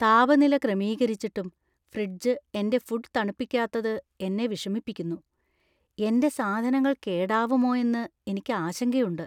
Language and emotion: Malayalam, fearful